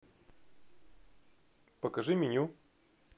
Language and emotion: Russian, neutral